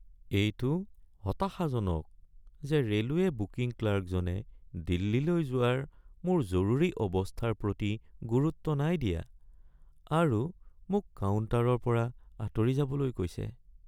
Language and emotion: Assamese, sad